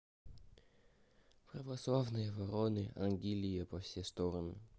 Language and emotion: Russian, sad